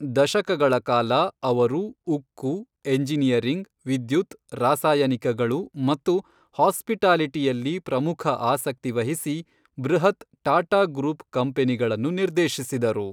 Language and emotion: Kannada, neutral